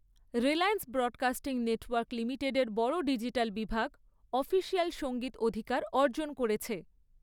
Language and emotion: Bengali, neutral